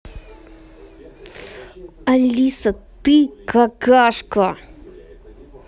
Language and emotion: Russian, angry